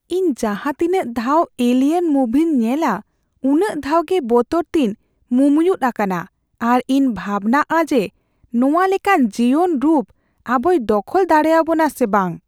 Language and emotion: Santali, fearful